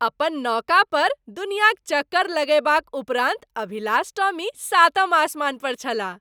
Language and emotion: Maithili, happy